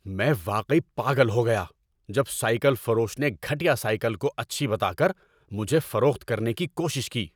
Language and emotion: Urdu, angry